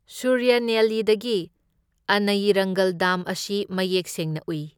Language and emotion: Manipuri, neutral